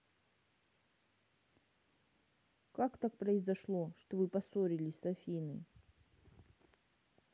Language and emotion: Russian, sad